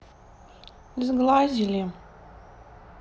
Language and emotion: Russian, sad